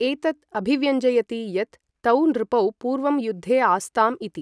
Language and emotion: Sanskrit, neutral